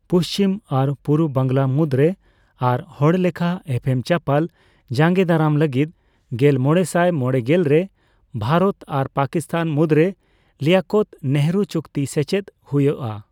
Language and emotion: Santali, neutral